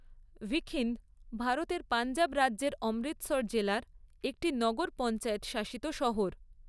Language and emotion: Bengali, neutral